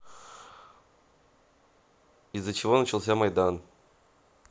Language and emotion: Russian, neutral